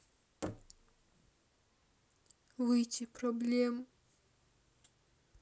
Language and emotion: Russian, sad